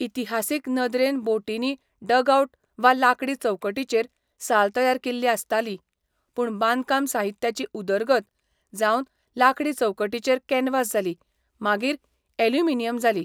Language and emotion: Goan Konkani, neutral